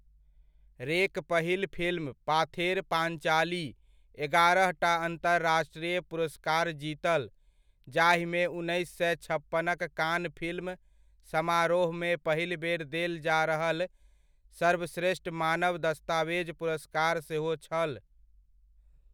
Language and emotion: Maithili, neutral